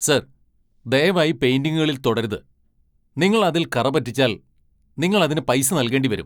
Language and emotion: Malayalam, angry